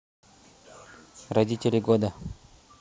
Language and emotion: Russian, neutral